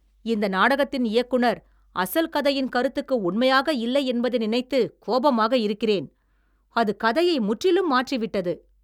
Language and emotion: Tamil, angry